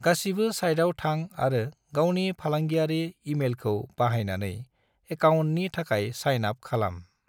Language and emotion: Bodo, neutral